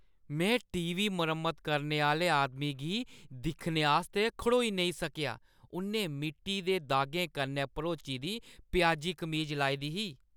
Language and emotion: Dogri, disgusted